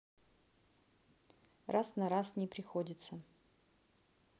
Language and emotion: Russian, neutral